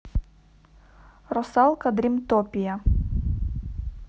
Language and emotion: Russian, neutral